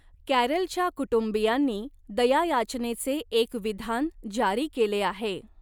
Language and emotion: Marathi, neutral